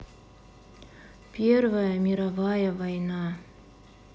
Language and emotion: Russian, sad